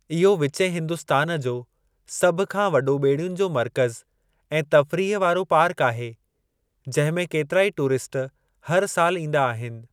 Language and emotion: Sindhi, neutral